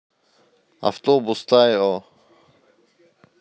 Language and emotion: Russian, neutral